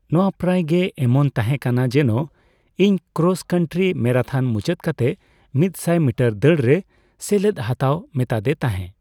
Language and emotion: Santali, neutral